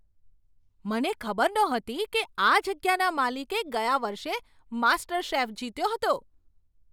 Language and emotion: Gujarati, surprised